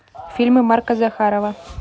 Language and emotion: Russian, neutral